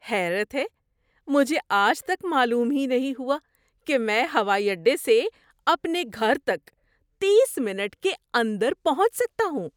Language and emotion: Urdu, surprised